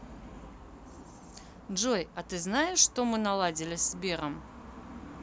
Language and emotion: Russian, neutral